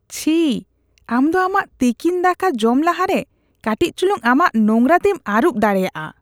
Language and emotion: Santali, disgusted